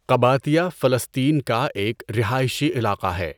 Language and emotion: Urdu, neutral